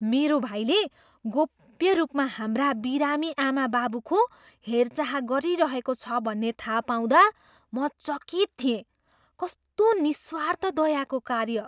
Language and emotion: Nepali, surprised